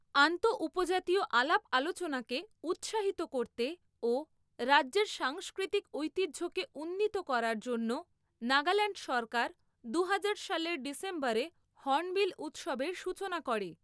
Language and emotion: Bengali, neutral